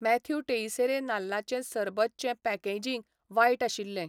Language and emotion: Goan Konkani, neutral